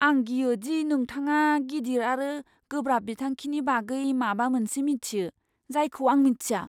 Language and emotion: Bodo, fearful